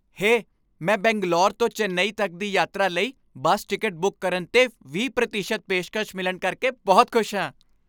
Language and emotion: Punjabi, happy